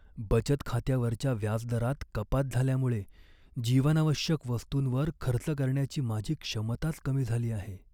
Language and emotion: Marathi, sad